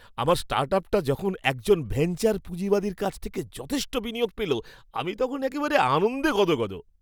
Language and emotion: Bengali, happy